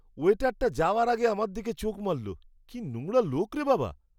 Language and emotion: Bengali, disgusted